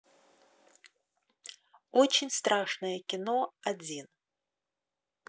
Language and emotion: Russian, neutral